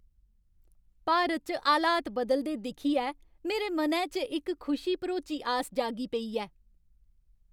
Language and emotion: Dogri, happy